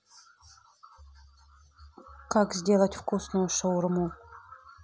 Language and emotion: Russian, neutral